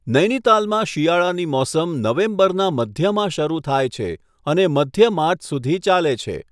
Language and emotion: Gujarati, neutral